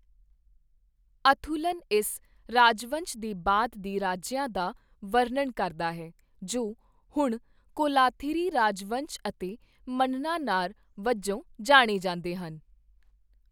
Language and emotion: Punjabi, neutral